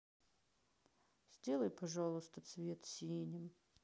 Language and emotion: Russian, sad